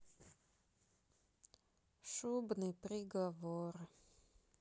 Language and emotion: Russian, sad